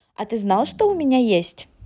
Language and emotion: Russian, positive